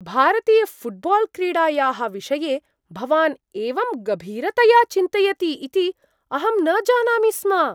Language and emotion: Sanskrit, surprised